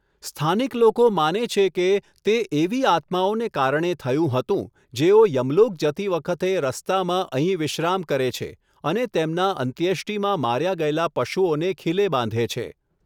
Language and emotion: Gujarati, neutral